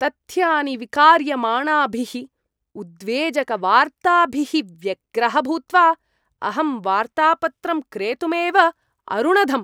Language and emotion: Sanskrit, disgusted